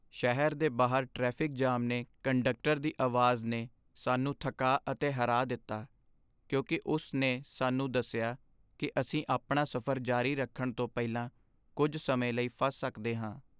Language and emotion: Punjabi, sad